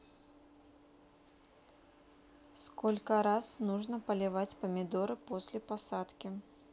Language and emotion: Russian, neutral